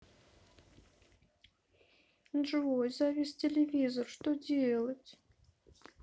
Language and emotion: Russian, sad